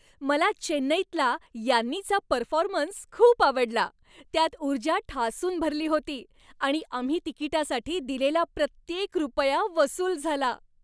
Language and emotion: Marathi, happy